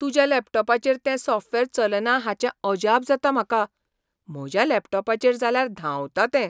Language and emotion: Goan Konkani, surprised